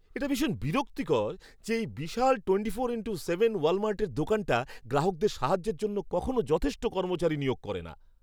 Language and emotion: Bengali, disgusted